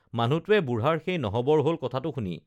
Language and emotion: Assamese, neutral